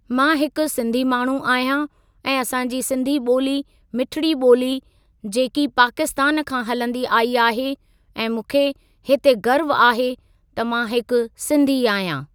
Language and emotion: Sindhi, neutral